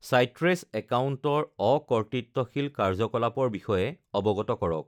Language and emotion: Assamese, neutral